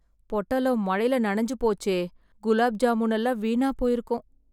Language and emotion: Tamil, sad